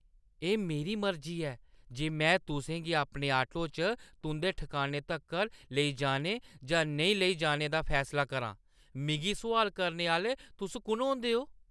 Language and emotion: Dogri, angry